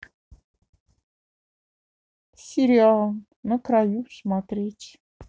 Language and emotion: Russian, sad